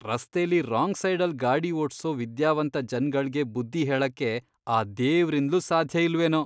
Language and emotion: Kannada, disgusted